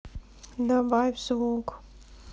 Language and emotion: Russian, neutral